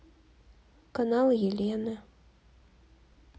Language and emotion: Russian, neutral